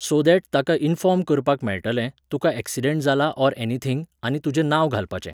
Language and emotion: Goan Konkani, neutral